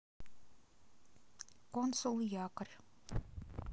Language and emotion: Russian, neutral